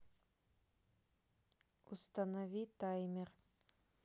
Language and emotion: Russian, neutral